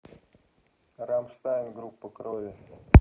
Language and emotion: Russian, neutral